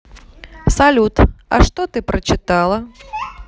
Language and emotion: Russian, neutral